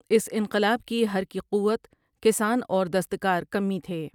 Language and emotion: Urdu, neutral